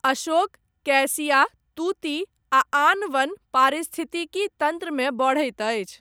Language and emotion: Maithili, neutral